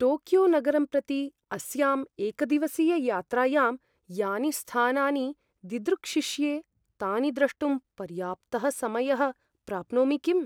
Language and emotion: Sanskrit, fearful